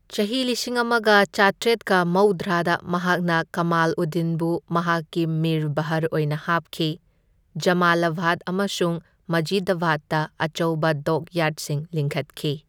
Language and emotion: Manipuri, neutral